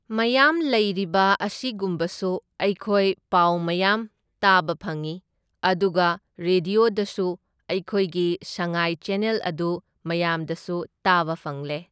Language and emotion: Manipuri, neutral